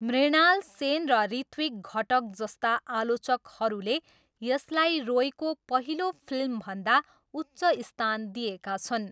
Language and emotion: Nepali, neutral